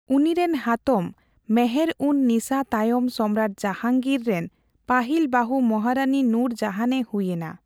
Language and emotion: Santali, neutral